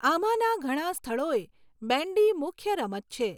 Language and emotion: Gujarati, neutral